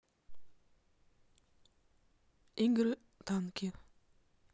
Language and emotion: Russian, neutral